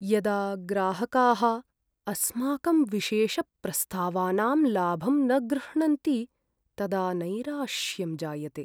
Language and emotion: Sanskrit, sad